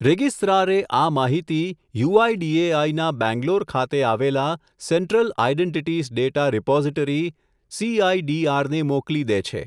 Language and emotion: Gujarati, neutral